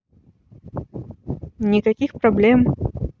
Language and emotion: Russian, neutral